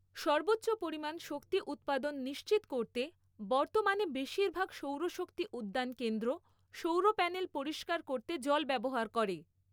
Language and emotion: Bengali, neutral